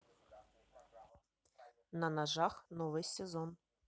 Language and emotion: Russian, neutral